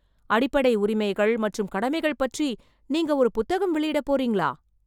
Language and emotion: Tamil, surprised